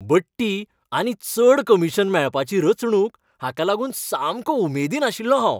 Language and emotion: Goan Konkani, happy